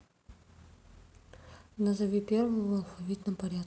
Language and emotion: Russian, neutral